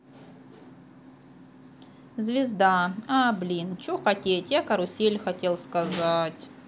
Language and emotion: Russian, sad